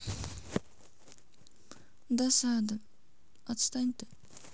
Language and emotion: Russian, sad